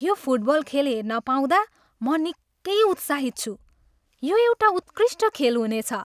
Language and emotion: Nepali, happy